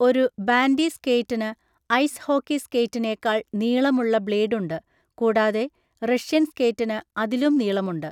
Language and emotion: Malayalam, neutral